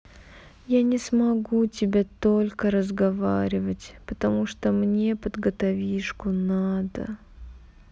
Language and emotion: Russian, sad